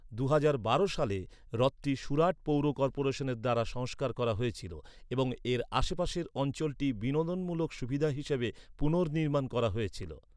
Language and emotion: Bengali, neutral